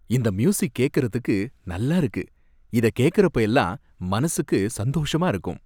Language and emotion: Tamil, happy